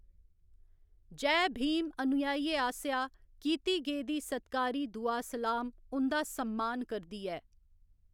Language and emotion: Dogri, neutral